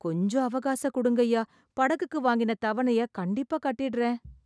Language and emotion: Tamil, sad